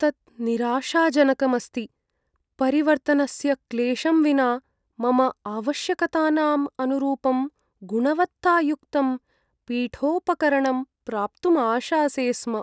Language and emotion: Sanskrit, sad